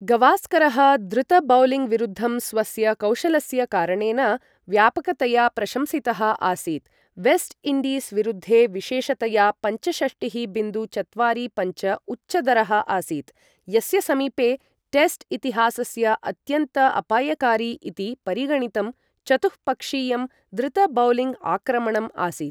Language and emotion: Sanskrit, neutral